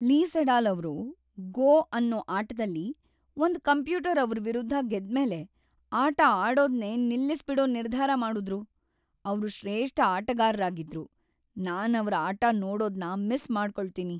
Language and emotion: Kannada, sad